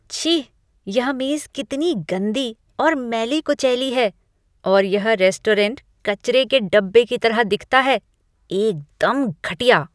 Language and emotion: Hindi, disgusted